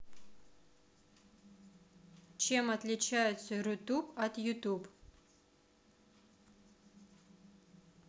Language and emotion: Russian, neutral